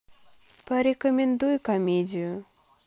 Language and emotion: Russian, sad